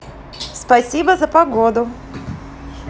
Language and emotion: Russian, positive